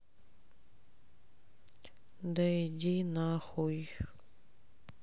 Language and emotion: Russian, sad